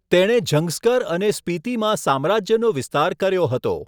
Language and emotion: Gujarati, neutral